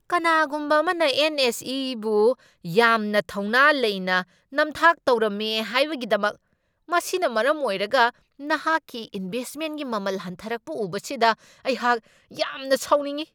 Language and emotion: Manipuri, angry